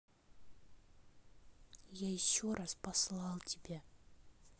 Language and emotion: Russian, angry